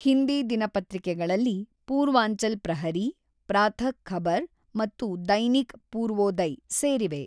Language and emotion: Kannada, neutral